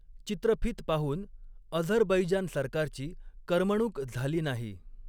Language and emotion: Marathi, neutral